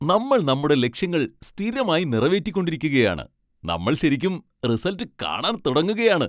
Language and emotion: Malayalam, happy